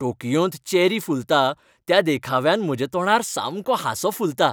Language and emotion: Goan Konkani, happy